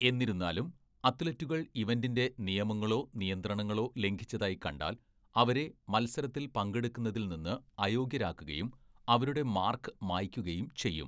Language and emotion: Malayalam, neutral